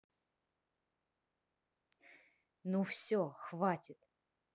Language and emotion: Russian, neutral